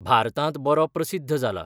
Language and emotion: Goan Konkani, neutral